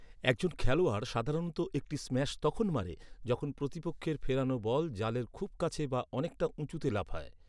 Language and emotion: Bengali, neutral